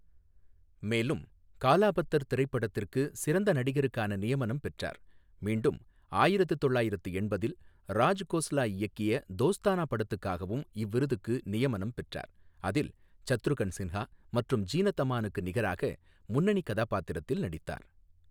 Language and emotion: Tamil, neutral